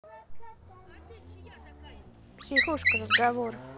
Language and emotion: Russian, neutral